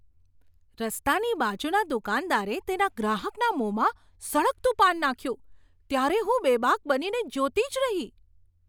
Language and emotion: Gujarati, surprised